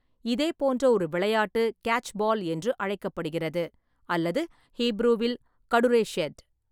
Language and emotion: Tamil, neutral